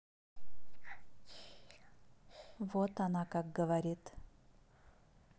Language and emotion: Russian, neutral